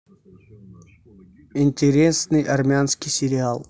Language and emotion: Russian, neutral